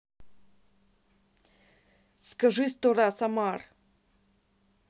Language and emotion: Russian, angry